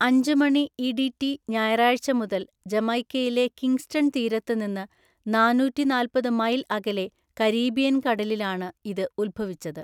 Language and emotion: Malayalam, neutral